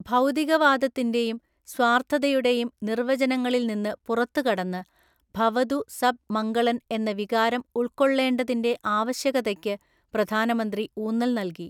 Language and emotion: Malayalam, neutral